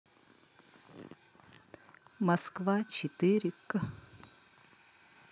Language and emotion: Russian, neutral